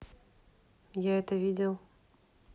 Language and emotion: Russian, neutral